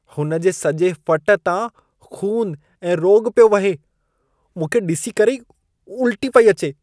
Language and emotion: Sindhi, disgusted